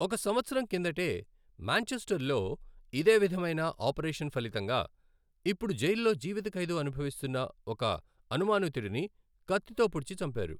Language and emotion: Telugu, neutral